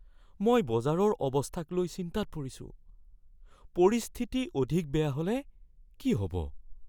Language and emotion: Assamese, fearful